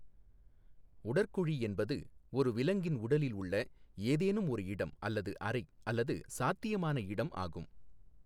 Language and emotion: Tamil, neutral